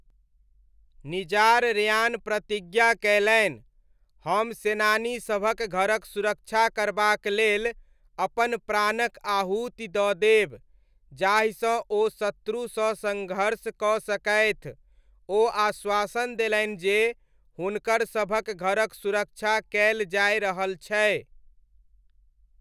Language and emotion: Maithili, neutral